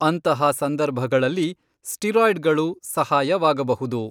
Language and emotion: Kannada, neutral